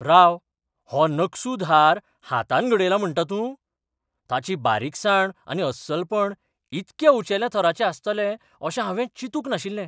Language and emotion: Goan Konkani, surprised